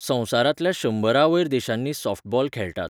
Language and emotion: Goan Konkani, neutral